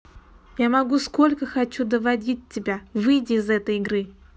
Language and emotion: Russian, neutral